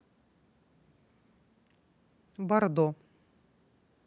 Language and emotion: Russian, neutral